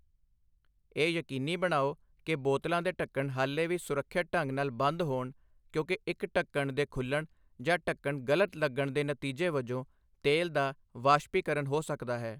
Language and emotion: Punjabi, neutral